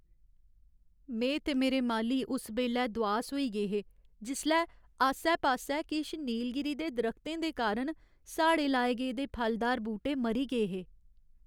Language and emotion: Dogri, sad